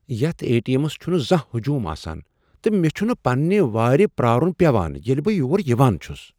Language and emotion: Kashmiri, surprised